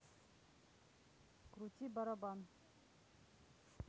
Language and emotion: Russian, neutral